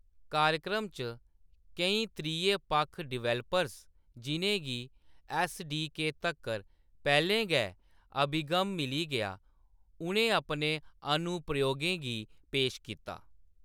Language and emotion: Dogri, neutral